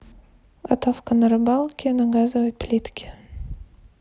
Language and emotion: Russian, neutral